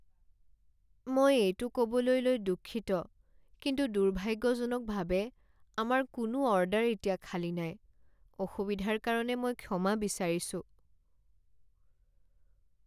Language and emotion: Assamese, sad